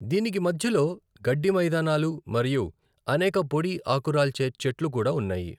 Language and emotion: Telugu, neutral